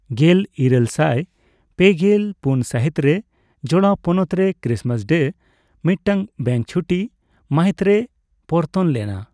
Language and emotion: Santali, neutral